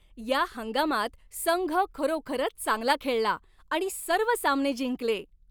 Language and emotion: Marathi, happy